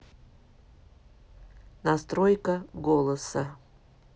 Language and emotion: Russian, neutral